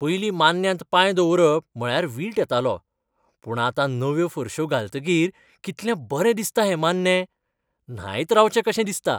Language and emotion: Goan Konkani, happy